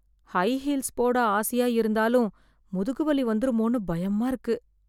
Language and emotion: Tamil, fearful